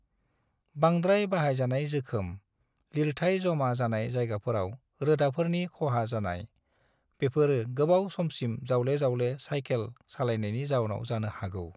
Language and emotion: Bodo, neutral